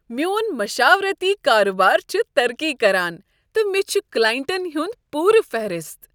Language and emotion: Kashmiri, happy